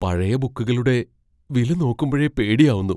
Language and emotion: Malayalam, fearful